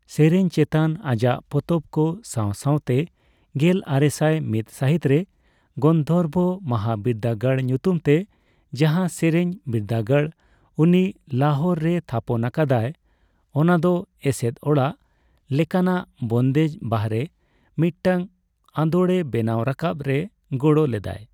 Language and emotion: Santali, neutral